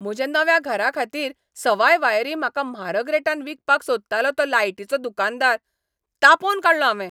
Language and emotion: Goan Konkani, angry